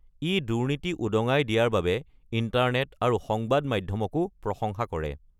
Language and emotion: Assamese, neutral